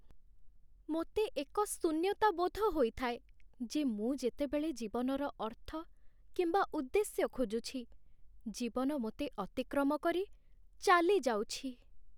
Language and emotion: Odia, sad